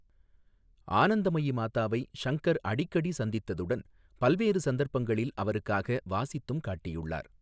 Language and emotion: Tamil, neutral